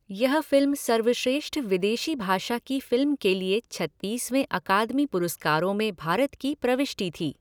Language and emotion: Hindi, neutral